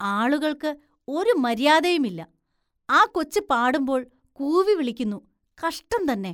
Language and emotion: Malayalam, disgusted